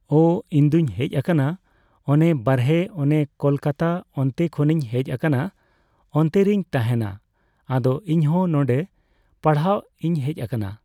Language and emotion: Santali, neutral